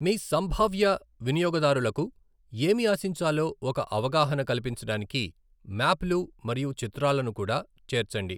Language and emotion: Telugu, neutral